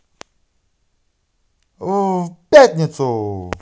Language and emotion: Russian, positive